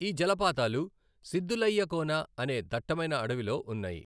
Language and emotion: Telugu, neutral